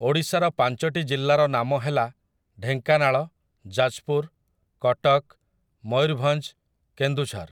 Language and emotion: Odia, neutral